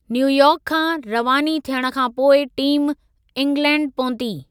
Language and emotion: Sindhi, neutral